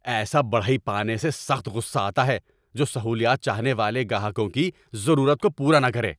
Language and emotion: Urdu, angry